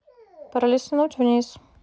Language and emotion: Russian, neutral